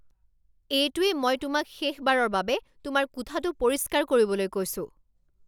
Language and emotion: Assamese, angry